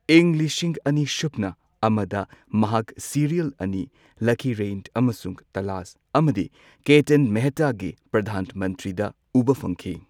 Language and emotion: Manipuri, neutral